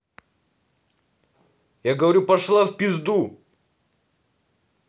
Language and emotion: Russian, angry